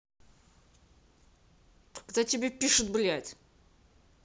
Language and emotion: Russian, angry